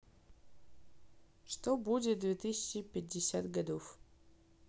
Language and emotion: Russian, neutral